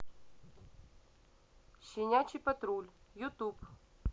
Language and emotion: Russian, neutral